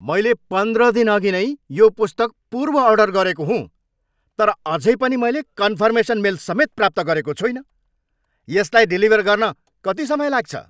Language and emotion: Nepali, angry